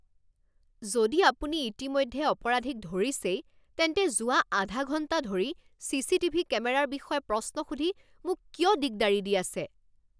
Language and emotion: Assamese, angry